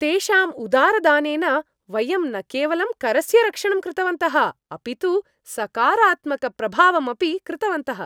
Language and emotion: Sanskrit, happy